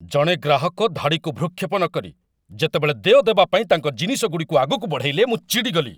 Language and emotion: Odia, angry